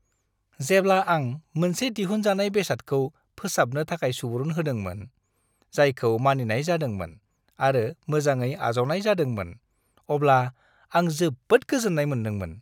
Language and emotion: Bodo, happy